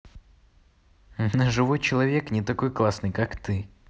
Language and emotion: Russian, positive